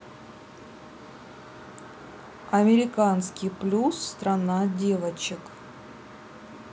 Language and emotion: Russian, neutral